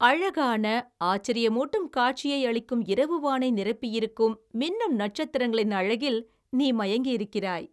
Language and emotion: Tamil, happy